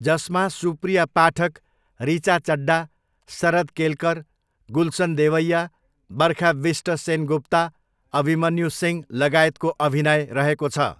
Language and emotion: Nepali, neutral